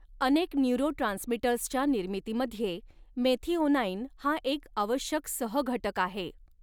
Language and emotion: Marathi, neutral